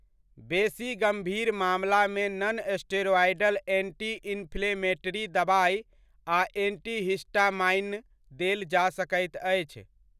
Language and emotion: Maithili, neutral